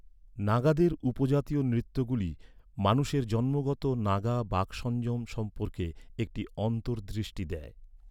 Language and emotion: Bengali, neutral